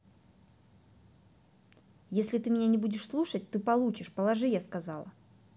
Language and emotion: Russian, angry